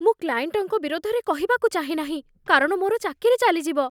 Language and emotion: Odia, fearful